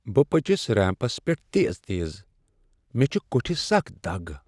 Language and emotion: Kashmiri, sad